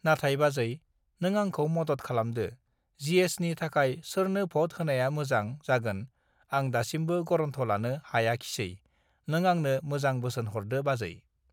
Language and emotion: Bodo, neutral